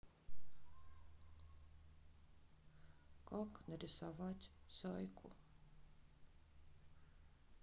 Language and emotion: Russian, sad